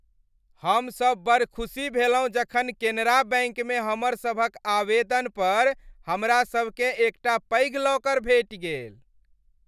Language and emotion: Maithili, happy